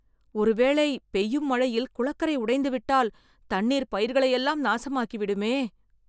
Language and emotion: Tamil, fearful